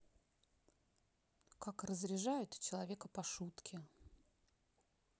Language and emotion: Russian, neutral